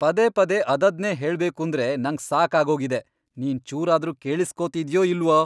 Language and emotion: Kannada, angry